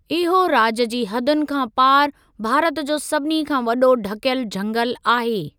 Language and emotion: Sindhi, neutral